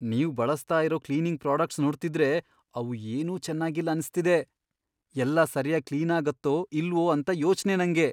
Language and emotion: Kannada, fearful